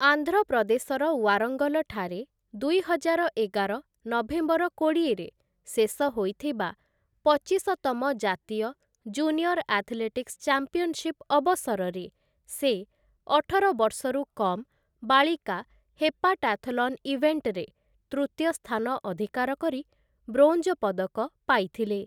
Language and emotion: Odia, neutral